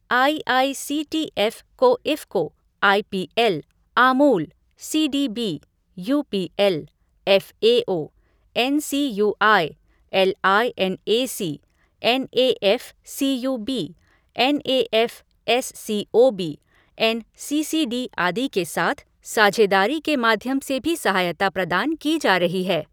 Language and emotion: Hindi, neutral